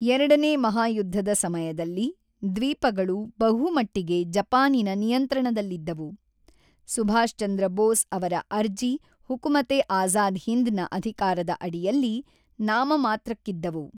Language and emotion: Kannada, neutral